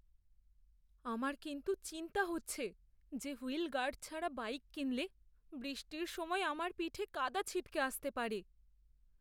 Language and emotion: Bengali, fearful